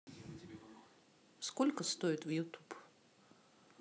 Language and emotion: Russian, neutral